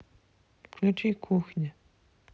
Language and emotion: Russian, neutral